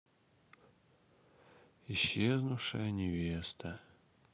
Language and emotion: Russian, sad